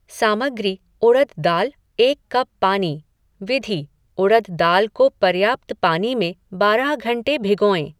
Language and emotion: Hindi, neutral